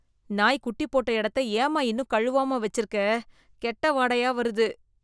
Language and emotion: Tamil, disgusted